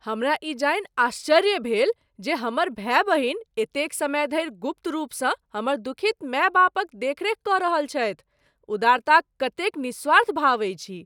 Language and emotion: Maithili, surprised